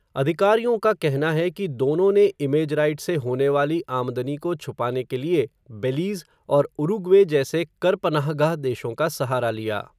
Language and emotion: Hindi, neutral